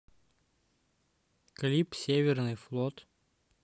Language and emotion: Russian, neutral